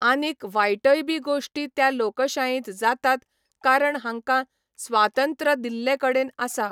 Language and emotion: Goan Konkani, neutral